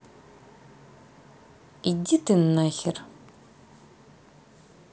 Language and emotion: Russian, angry